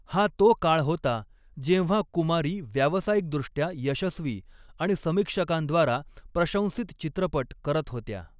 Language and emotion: Marathi, neutral